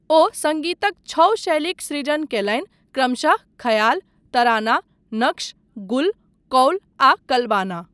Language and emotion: Maithili, neutral